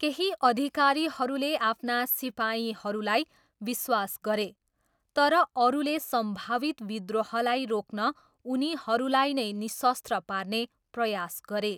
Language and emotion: Nepali, neutral